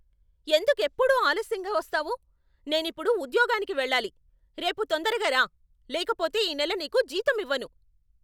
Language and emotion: Telugu, angry